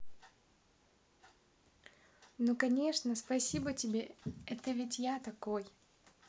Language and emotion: Russian, positive